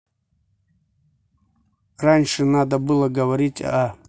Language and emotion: Russian, neutral